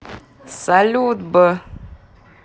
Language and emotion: Russian, positive